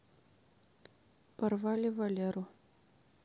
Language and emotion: Russian, neutral